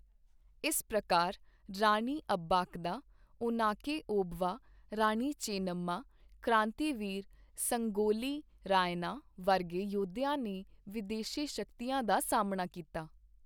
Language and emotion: Punjabi, neutral